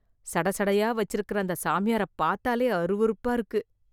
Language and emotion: Tamil, disgusted